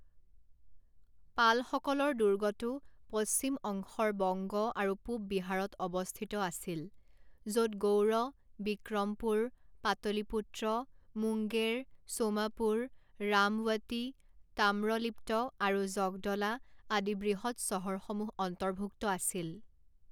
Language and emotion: Assamese, neutral